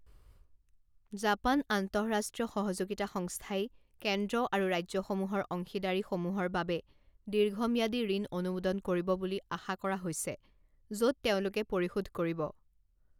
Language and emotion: Assamese, neutral